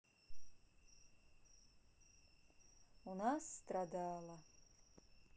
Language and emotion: Russian, sad